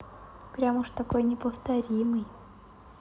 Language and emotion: Russian, neutral